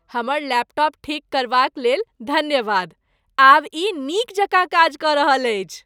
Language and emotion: Maithili, happy